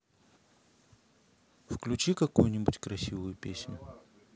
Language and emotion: Russian, neutral